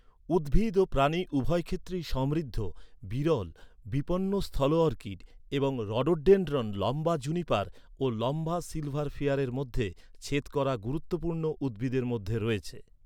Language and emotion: Bengali, neutral